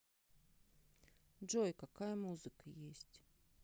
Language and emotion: Russian, sad